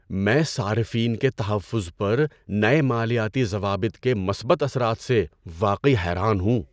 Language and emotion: Urdu, surprised